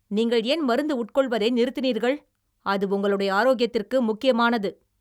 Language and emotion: Tamil, angry